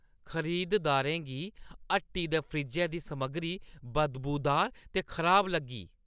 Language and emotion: Dogri, disgusted